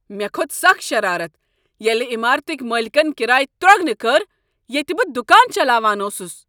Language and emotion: Kashmiri, angry